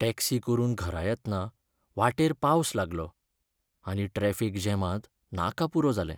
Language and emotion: Goan Konkani, sad